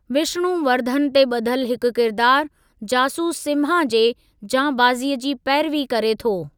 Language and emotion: Sindhi, neutral